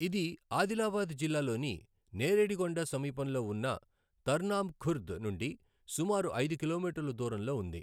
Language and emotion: Telugu, neutral